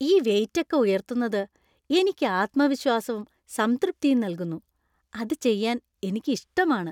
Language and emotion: Malayalam, happy